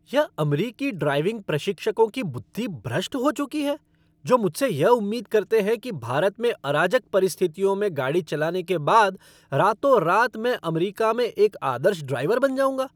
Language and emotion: Hindi, angry